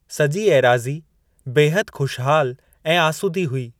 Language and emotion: Sindhi, neutral